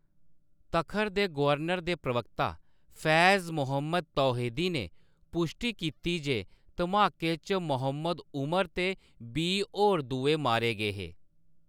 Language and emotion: Dogri, neutral